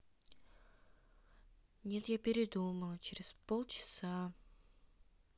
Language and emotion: Russian, sad